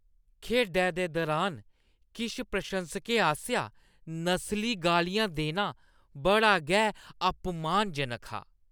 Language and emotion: Dogri, disgusted